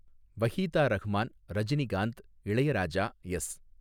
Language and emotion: Tamil, neutral